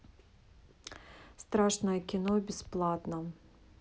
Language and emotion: Russian, neutral